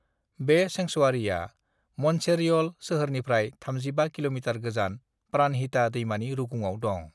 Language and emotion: Bodo, neutral